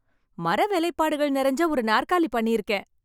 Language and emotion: Tamil, happy